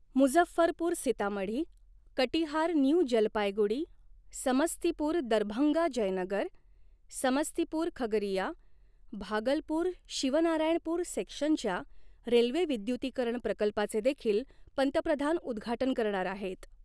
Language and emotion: Marathi, neutral